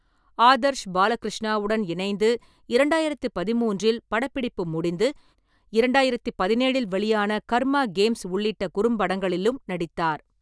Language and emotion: Tamil, neutral